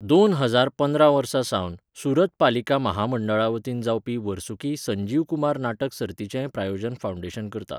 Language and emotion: Goan Konkani, neutral